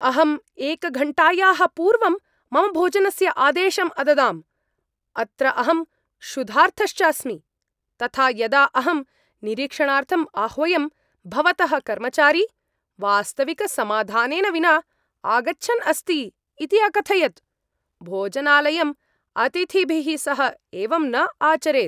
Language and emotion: Sanskrit, angry